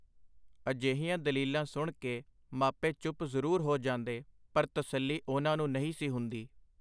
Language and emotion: Punjabi, neutral